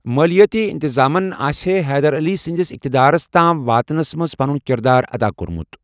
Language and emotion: Kashmiri, neutral